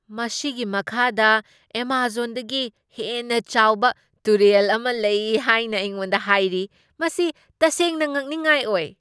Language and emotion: Manipuri, surprised